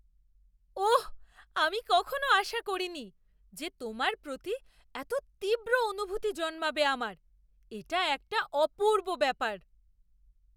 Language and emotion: Bengali, surprised